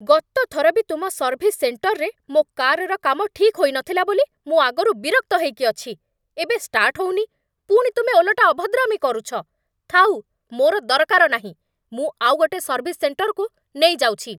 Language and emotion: Odia, angry